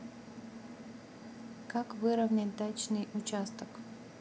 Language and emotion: Russian, neutral